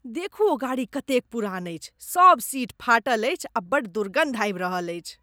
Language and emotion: Maithili, disgusted